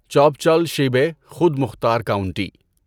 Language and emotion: Urdu, neutral